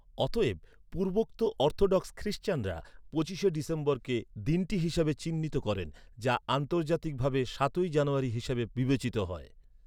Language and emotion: Bengali, neutral